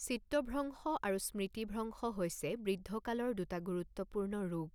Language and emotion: Assamese, neutral